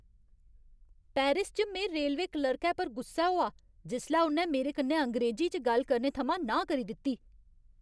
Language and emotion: Dogri, angry